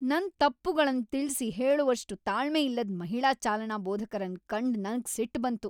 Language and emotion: Kannada, angry